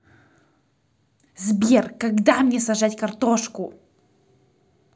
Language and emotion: Russian, angry